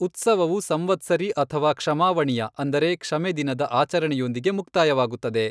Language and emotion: Kannada, neutral